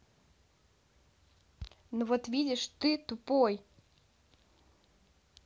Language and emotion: Russian, angry